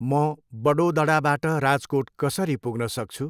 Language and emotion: Nepali, neutral